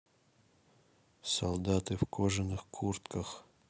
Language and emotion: Russian, neutral